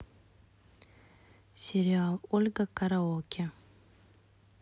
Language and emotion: Russian, neutral